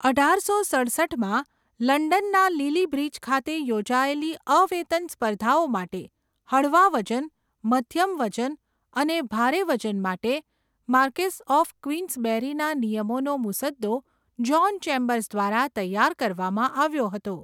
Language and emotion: Gujarati, neutral